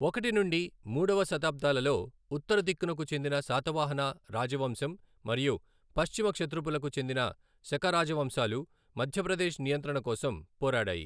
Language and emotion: Telugu, neutral